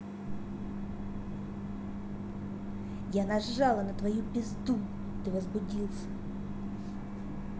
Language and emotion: Russian, angry